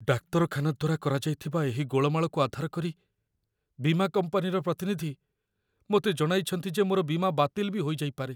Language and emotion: Odia, fearful